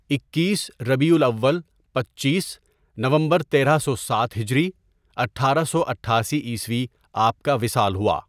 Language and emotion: Urdu, neutral